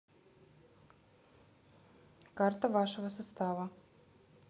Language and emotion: Russian, neutral